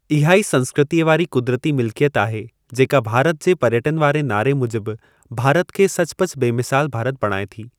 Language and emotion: Sindhi, neutral